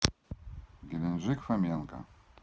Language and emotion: Russian, neutral